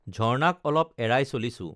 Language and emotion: Assamese, neutral